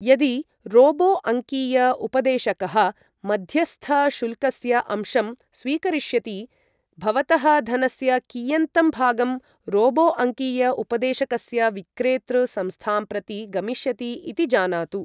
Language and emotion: Sanskrit, neutral